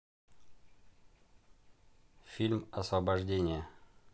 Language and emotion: Russian, neutral